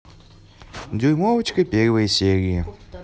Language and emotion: Russian, neutral